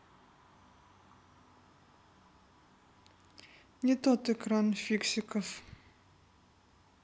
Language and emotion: Russian, neutral